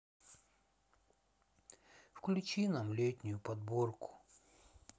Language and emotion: Russian, sad